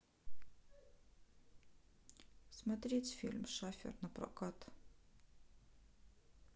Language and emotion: Russian, neutral